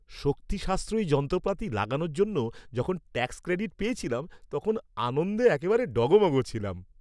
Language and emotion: Bengali, happy